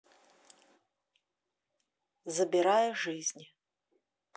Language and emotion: Russian, neutral